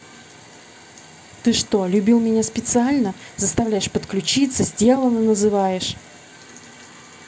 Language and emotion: Russian, angry